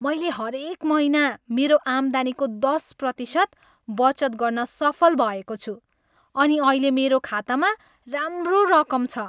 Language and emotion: Nepali, happy